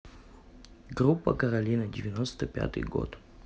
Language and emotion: Russian, neutral